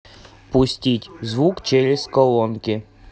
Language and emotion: Russian, neutral